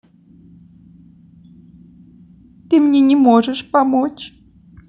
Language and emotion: Russian, sad